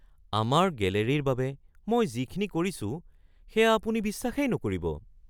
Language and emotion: Assamese, surprised